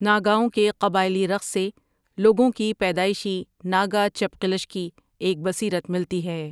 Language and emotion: Urdu, neutral